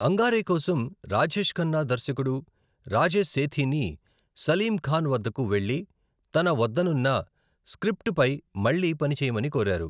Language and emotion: Telugu, neutral